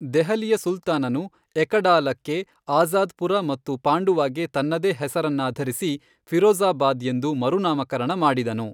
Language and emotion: Kannada, neutral